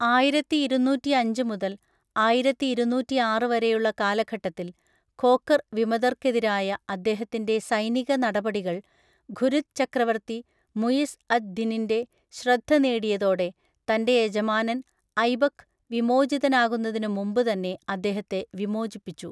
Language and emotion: Malayalam, neutral